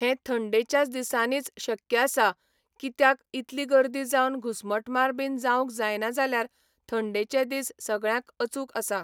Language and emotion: Goan Konkani, neutral